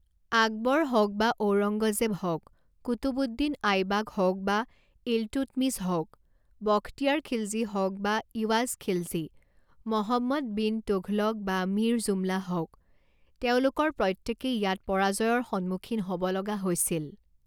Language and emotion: Assamese, neutral